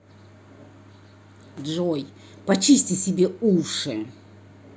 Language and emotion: Russian, angry